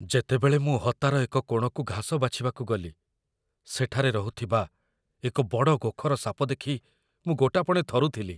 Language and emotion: Odia, fearful